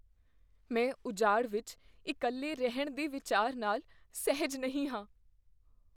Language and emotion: Punjabi, fearful